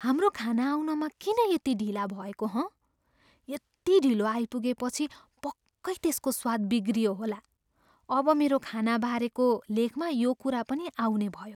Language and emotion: Nepali, fearful